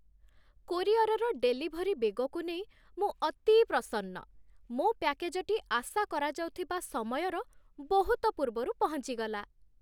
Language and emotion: Odia, happy